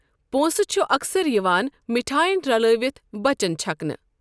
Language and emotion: Kashmiri, neutral